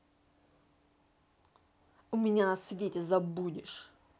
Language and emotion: Russian, angry